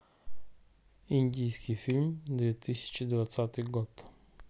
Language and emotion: Russian, neutral